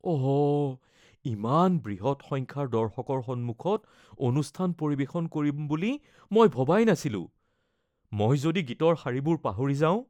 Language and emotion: Assamese, fearful